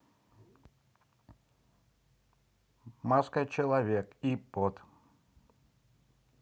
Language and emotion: Russian, neutral